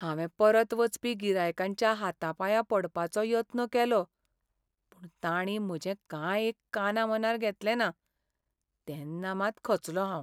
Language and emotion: Goan Konkani, sad